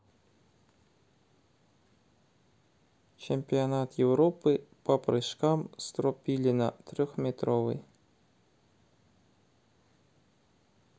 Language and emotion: Russian, neutral